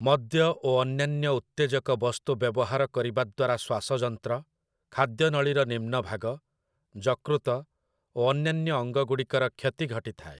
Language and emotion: Odia, neutral